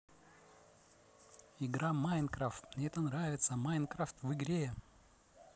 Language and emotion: Russian, positive